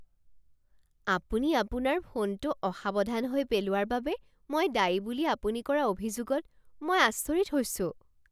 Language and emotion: Assamese, surprised